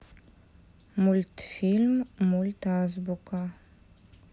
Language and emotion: Russian, neutral